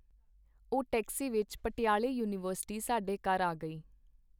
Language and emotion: Punjabi, neutral